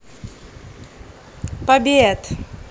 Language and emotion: Russian, positive